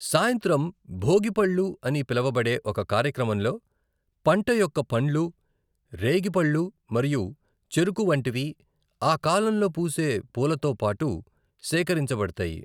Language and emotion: Telugu, neutral